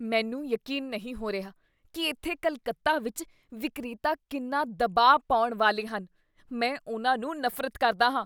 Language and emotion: Punjabi, disgusted